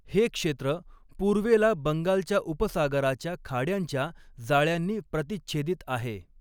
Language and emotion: Marathi, neutral